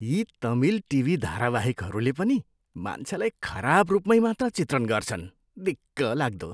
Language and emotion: Nepali, disgusted